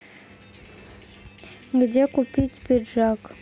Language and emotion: Russian, neutral